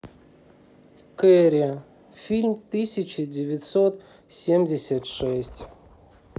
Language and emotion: Russian, neutral